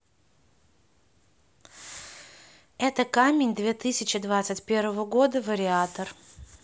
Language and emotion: Russian, neutral